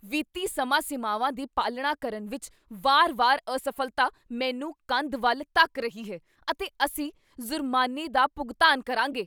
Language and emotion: Punjabi, angry